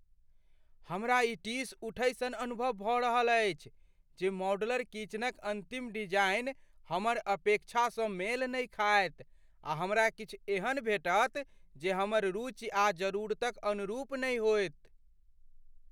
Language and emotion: Maithili, fearful